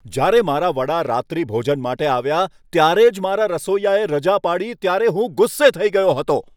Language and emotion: Gujarati, angry